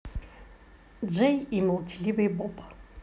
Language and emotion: Russian, positive